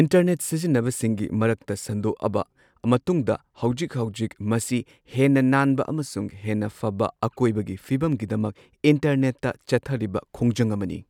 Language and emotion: Manipuri, neutral